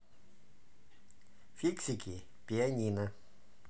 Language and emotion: Russian, neutral